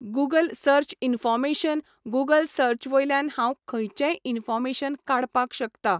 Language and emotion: Goan Konkani, neutral